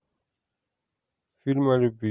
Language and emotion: Russian, neutral